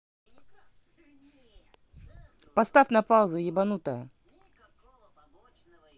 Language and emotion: Russian, angry